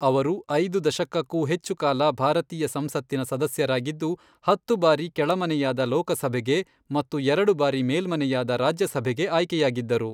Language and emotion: Kannada, neutral